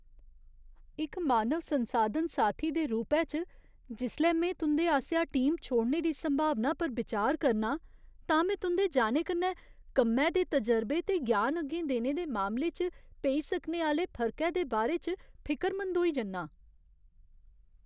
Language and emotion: Dogri, fearful